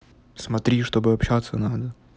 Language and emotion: Russian, neutral